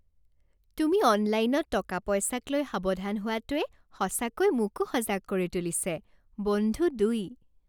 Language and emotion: Assamese, happy